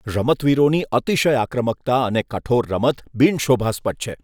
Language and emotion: Gujarati, disgusted